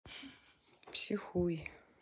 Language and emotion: Russian, sad